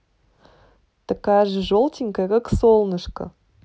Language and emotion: Russian, positive